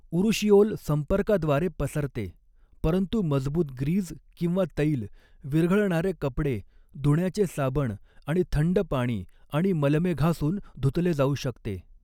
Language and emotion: Marathi, neutral